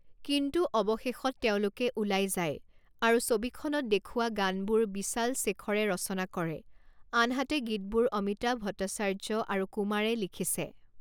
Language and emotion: Assamese, neutral